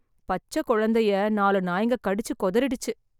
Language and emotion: Tamil, sad